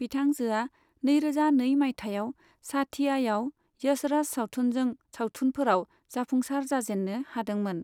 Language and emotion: Bodo, neutral